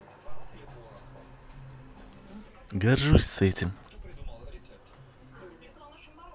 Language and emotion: Russian, positive